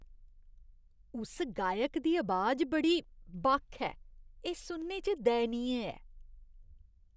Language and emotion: Dogri, disgusted